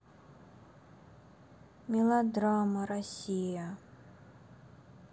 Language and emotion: Russian, sad